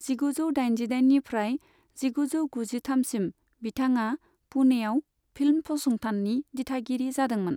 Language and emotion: Bodo, neutral